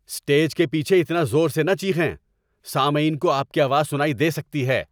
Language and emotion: Urdu, angry